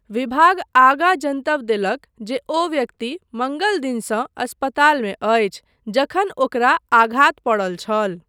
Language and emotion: Maithili, neutral